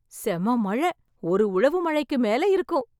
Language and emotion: Tamil, happy